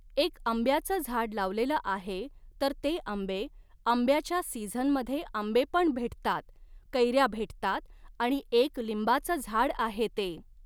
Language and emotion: Marathi, neutral